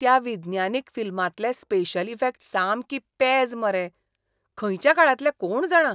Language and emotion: Goan Konkani, disgusted